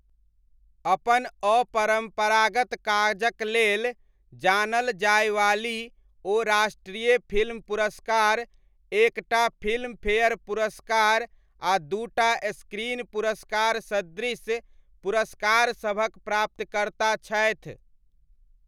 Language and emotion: Maithili, neutral